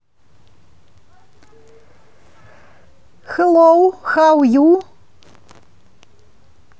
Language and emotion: Russian, positive